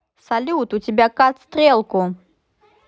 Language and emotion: Russian, positive